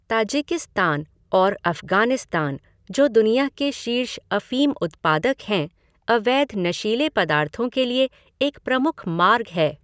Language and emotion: Hindi, neutral